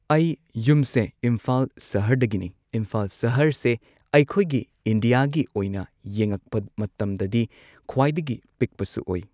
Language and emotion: Manipuri, neutral